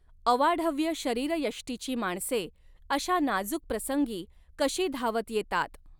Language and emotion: Marathi, neutral